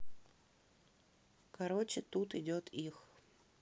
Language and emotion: Russian, neutral